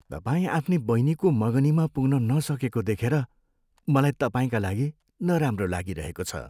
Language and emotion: Nepali, sad